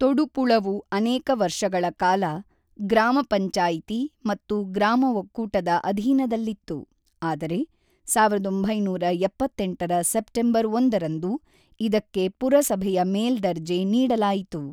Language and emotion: Kannada, neutral